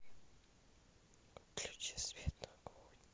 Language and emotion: Russian, neutral